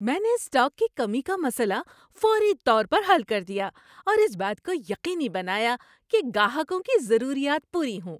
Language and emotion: Urdu, happy